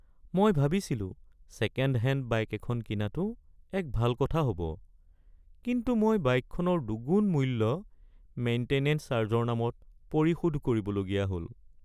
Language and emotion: Assamese, sad